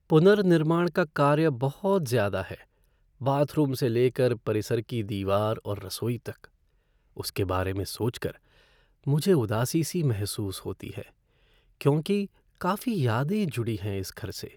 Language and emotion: Hindi, sad